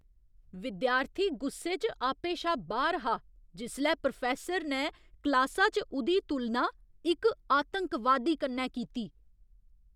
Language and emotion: Dogri, angry